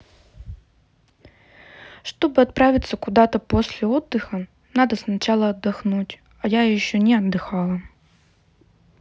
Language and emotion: Russian, sad